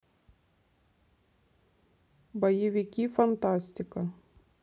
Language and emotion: Russian, neutral